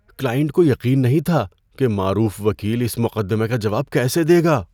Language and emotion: Urdu, fearful